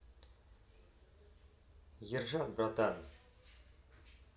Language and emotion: Russian, neutral